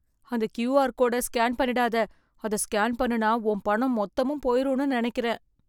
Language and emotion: Tamil, fearful